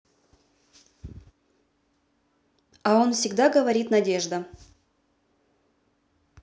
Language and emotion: Russian, neutral